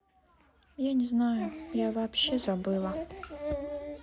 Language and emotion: Russian, sad